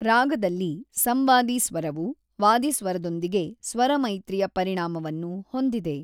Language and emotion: Kannada, neutral